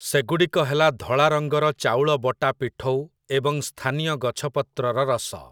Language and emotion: Odia, neutral